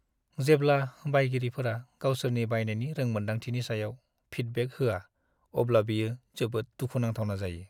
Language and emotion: Bodo, sad